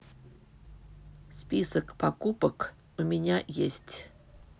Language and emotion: Russian, neutral